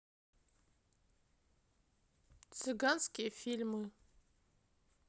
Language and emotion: Russian, neutral